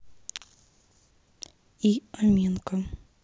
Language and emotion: Russian, neutral